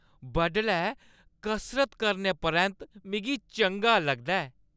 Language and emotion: Dogri, happy